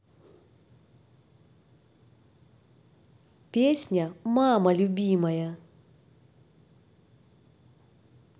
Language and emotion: Russian, positive